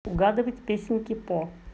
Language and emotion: Russian, neutral